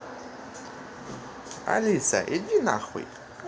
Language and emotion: Russian, positive